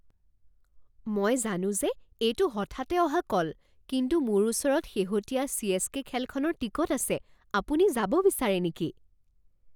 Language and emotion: Assamese, surprised